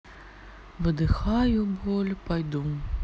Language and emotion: Russian, sad